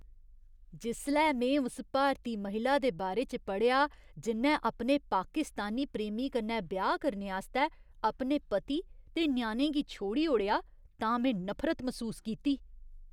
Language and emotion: Dogri, disgusted